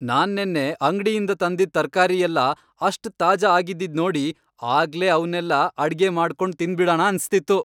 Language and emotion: Kannada, happy